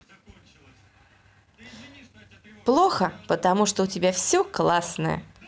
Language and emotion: Russian, positive